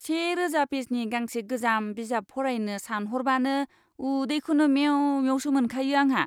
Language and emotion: Bodo, disgusted